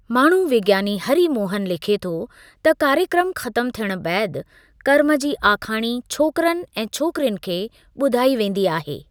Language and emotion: Sindhi, neutral